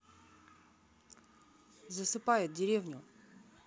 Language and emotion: Russian, neutral